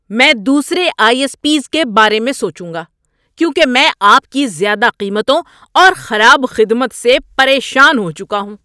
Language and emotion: Urdu, angry